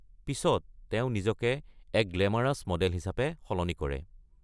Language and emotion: Assamese, neutral